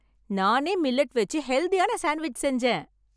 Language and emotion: Tamil, happy